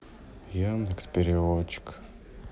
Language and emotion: Russian, sad